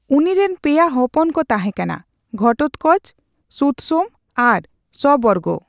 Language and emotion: Santali, neutral